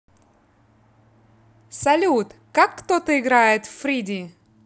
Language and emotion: Russian, positive